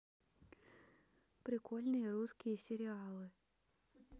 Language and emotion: Russian, neutral